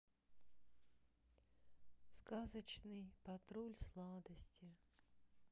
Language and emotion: Russian, sad